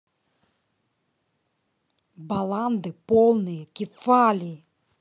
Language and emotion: Russian, angry